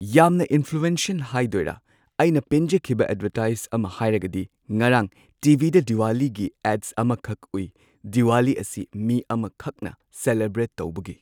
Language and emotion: Manipuri, neutral